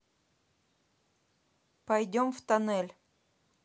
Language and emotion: Russian, neutral